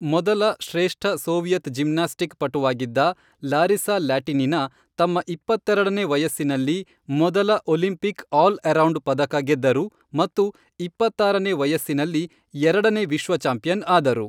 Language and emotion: Kannada, neutral